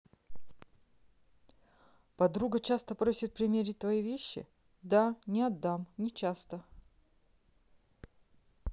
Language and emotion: Russian, neutral